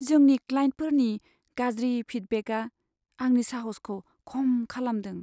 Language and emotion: Bodo, sad